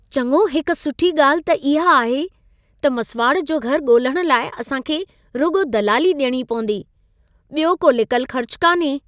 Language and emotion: Sindhi, happy